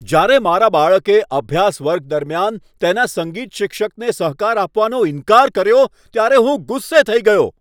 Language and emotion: Gujarati, angry